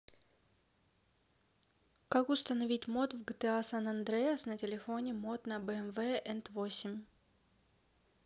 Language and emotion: Russian, neutral